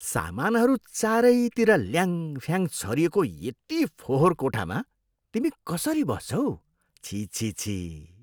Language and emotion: Nepali, disgusted